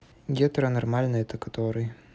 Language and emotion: Russian, neutral